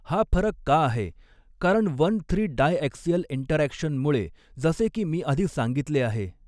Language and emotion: Marathi, neutral